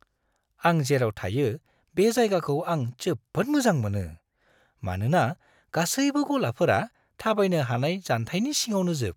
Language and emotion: Bodo, happy